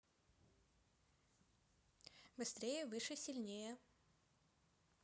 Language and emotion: Russian, neutral